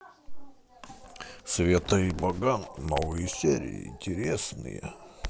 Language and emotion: Russian, positive